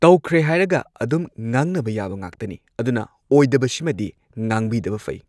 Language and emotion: Manipuri, neutral